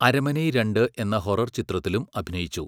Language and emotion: Malayalam, neutral